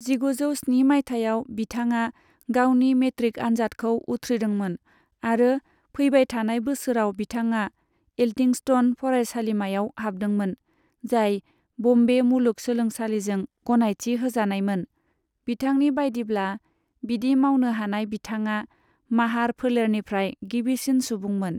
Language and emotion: Bodo, neutral